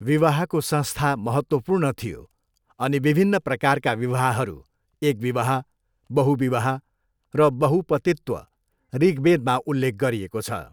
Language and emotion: Nepali, neutral